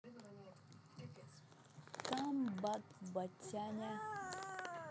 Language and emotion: Russian, positive